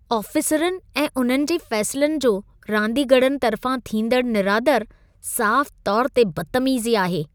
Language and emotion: Sindhi, disgusted